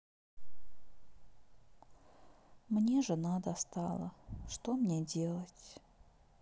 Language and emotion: Russian, sad